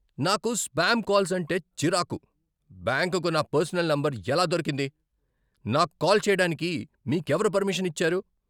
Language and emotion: Telugu, angry